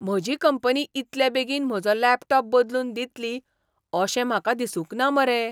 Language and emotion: Goan Konkani, surprised